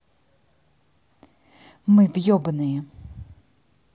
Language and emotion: Russian, angry